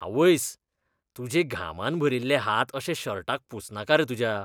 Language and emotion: Goan Konkani, disgusted